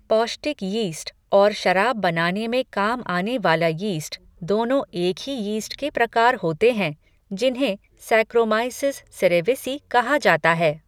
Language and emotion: Hindi, neutral